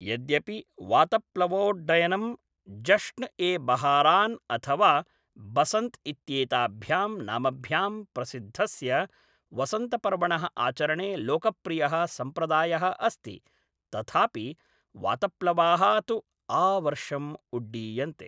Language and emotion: Sanskrit, neutral